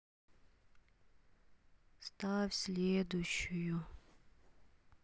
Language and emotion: Russian, sad